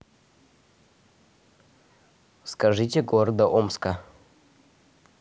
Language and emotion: Russian, neutral